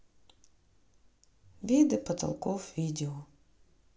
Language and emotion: Russian, neutral